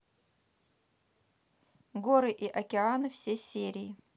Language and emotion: Russian, neutral